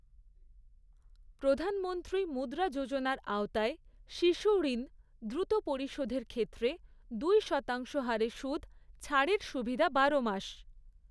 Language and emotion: Bengali, neutral